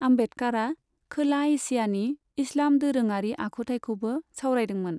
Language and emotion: Bodo, neutral